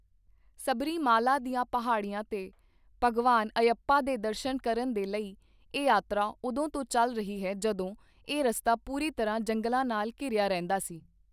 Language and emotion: Punjabi, neutral